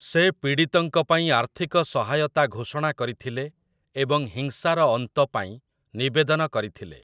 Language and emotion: Odia, neutral